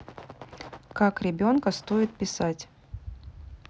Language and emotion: Russian, neutral